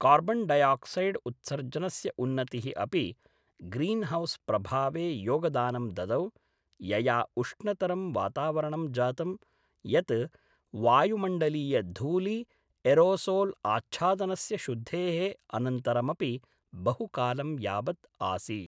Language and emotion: Sanskrit, neutral